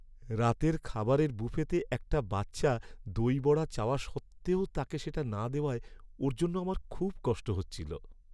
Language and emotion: Bengali, sad